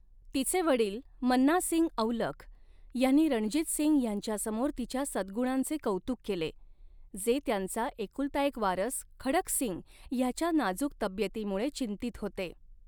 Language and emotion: Marathi, neutral